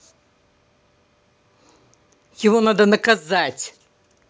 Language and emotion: Russian, angry